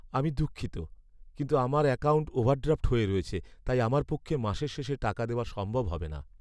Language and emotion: Bengali, sad